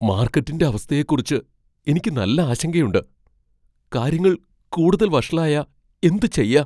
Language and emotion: Malayalam, fearful